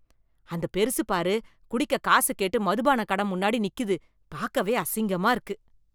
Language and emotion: Tamil, disgusted